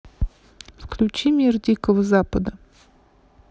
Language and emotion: Russian, neutral